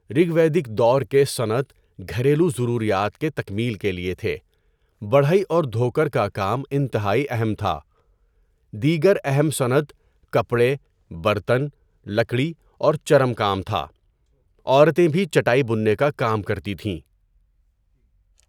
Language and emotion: Urdu, neutral